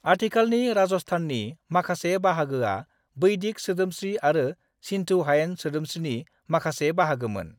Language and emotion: Bodo, neutral